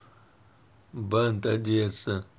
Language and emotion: Russian, neutral